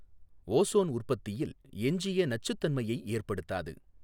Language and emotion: Tamil, neutral